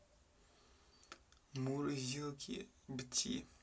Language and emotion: Russian, neutral